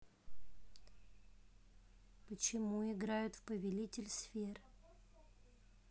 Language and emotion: Russian, neutral